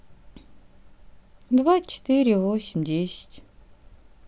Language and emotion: Russian, sad